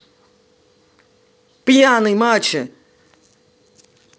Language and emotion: Russian, angry